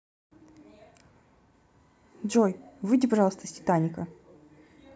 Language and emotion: Russian, angry